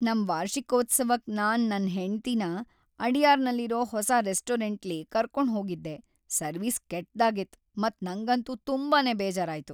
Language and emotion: Kannada, sad